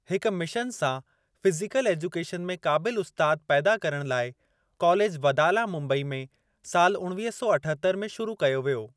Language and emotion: Sindhi, neutral